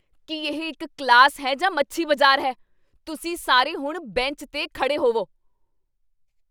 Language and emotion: Punjabi, angry